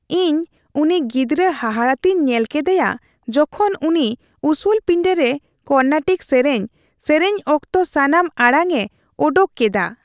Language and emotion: Santali, happy